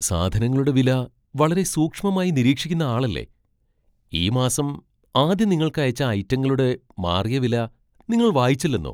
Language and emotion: Malayalam, surprised